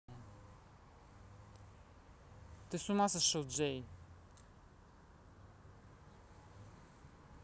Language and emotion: Russian, angry